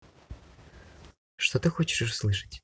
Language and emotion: Russian, neutral